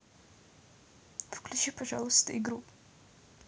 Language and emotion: Russian, neutral